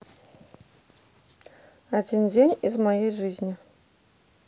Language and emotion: Russian, neutral